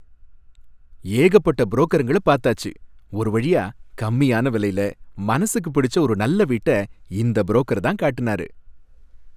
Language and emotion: Tamil, happy